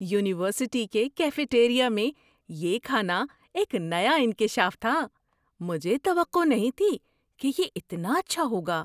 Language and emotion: Urdu, surprised